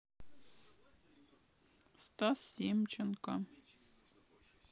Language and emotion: Russian, neutral